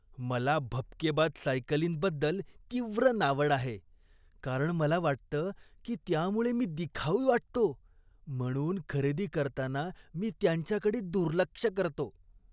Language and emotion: Marathi, disgusted